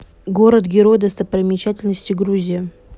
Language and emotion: Russian, neutral